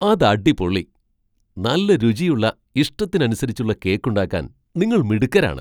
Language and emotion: Malayalam, surprised